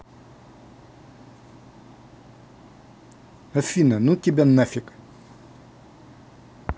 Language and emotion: Russian, angry